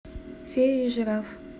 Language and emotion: Russian, neutral